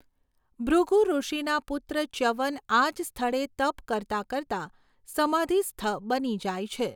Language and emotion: Gujarati, neutral